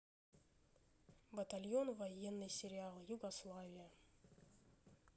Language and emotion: Russian, neutral